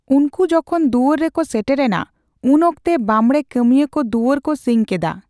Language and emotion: Santali, neutral